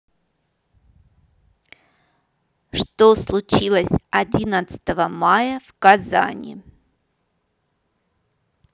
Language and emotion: Russian, neutral